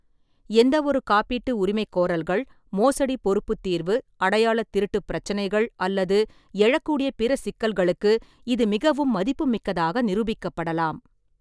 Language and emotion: Tamil, neutral